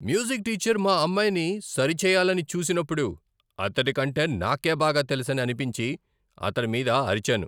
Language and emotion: Telugu, angry